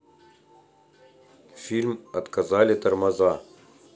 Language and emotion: Russian, neutral